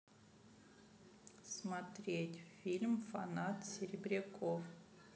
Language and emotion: Russian, neutral